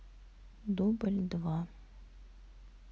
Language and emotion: Russian, sad